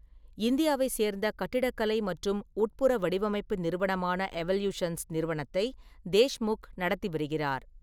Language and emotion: Tamil, neutral